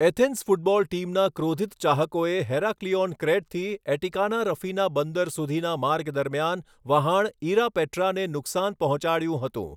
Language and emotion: Gujarati, neutral